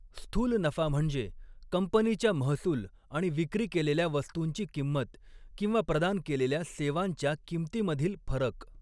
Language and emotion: Marathi, neutral